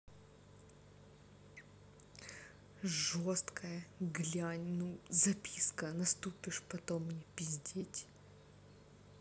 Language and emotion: Russian, angry